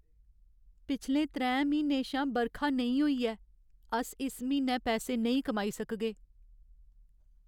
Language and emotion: Dogri, sad